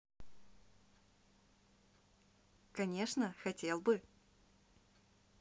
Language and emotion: Russian, positive